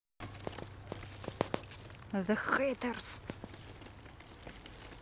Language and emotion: Russian, angry